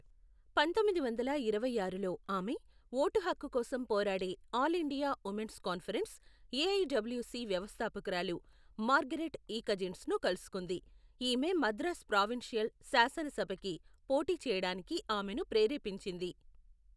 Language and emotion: Telugu, neutral